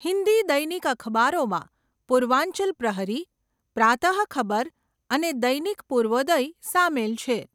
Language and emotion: Gujarati, neutral